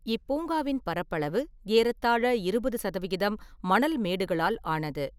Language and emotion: Tamil, neutral